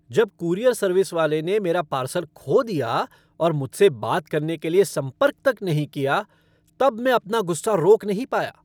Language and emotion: Hindi, angry